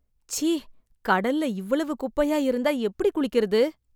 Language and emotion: Tamil, disgusted